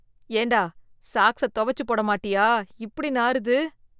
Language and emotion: Tamil, disgusted